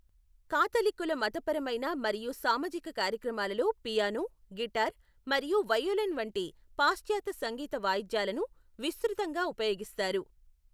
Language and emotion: Telugu, neutral